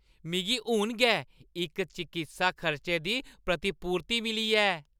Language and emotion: Dogri, happy